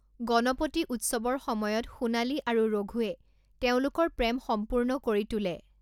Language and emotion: Assamese, neutral